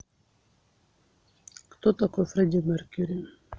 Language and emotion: Russian, neutral